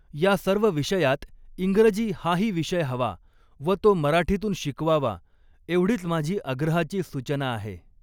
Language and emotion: Marathi, neutral